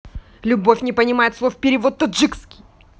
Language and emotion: Russian, angry